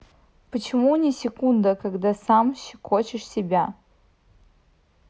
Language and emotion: Russian, neutral